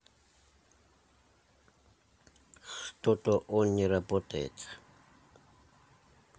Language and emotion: Russian, neutral